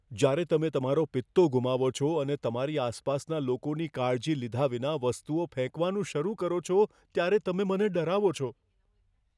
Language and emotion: Gujarati, fearful